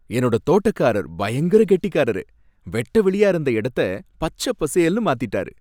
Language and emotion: Tamil, happy